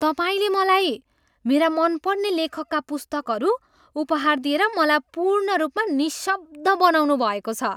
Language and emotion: Nepali, surprised